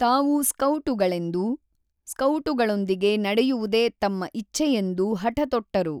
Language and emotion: Kannada, neutral